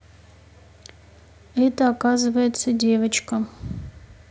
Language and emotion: Russian, neutral